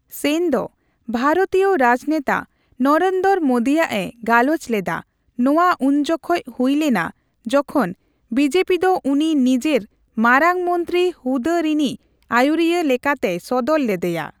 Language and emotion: Santali, neutral